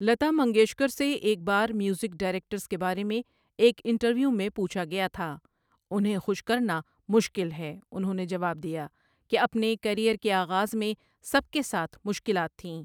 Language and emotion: Urdu, neutral